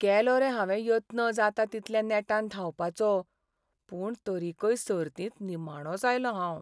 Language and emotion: Goan Konkani, sad